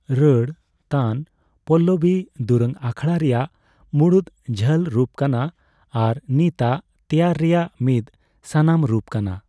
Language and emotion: Santali, neutral